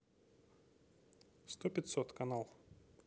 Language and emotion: Russian, neutral